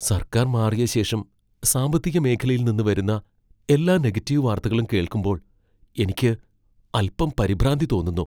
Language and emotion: Malayalam, fearful